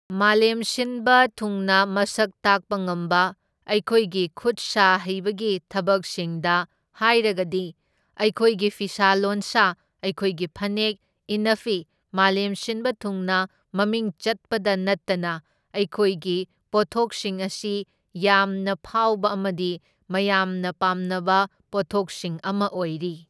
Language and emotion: Manipuri, neutral